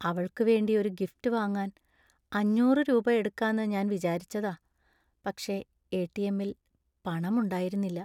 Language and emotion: Malayalam, sad